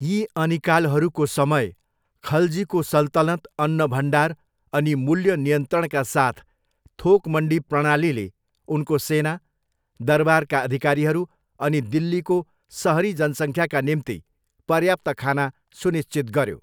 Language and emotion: Nepali, neutral